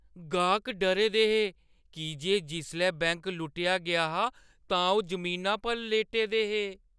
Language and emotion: Dogri, fearful